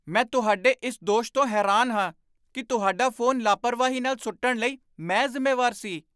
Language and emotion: Punjabi, surprised